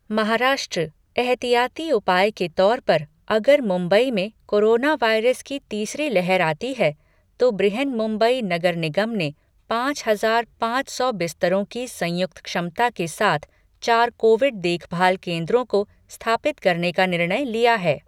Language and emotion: Hindi, neutral